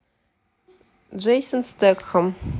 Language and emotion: Russian, neutral